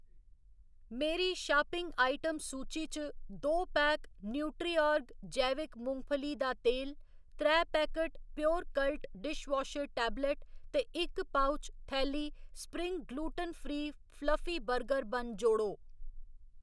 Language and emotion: Dogri, neutral